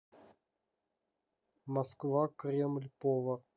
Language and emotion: Russian, neutral